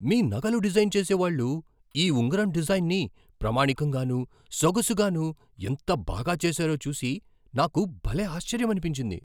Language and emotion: Telugu, surprised